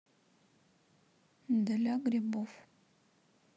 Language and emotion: Russian, neutral